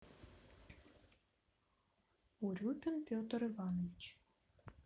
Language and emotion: Russian, neutral